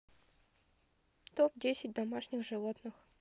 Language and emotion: Russian, neutral